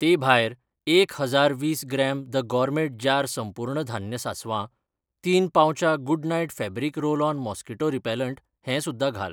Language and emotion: Goan Konkani, neutral